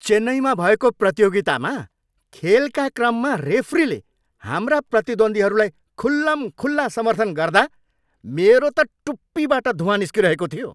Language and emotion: Nepali, angry